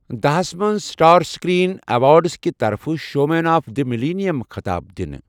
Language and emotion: Kashmiri, neutral